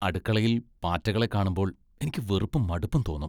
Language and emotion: Malayalam, disgusted